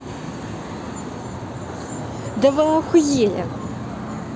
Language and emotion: Russian, angry